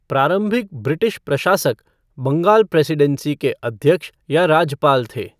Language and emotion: Hindi, neutral